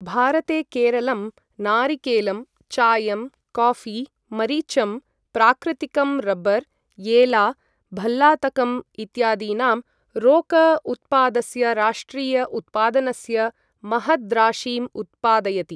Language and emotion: Sanskrit, neutral